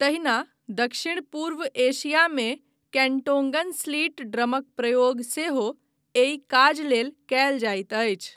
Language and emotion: Maithili, neutral